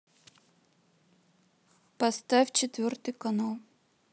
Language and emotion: Russian, neutral